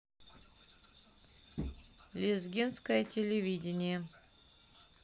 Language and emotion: Russian, neutral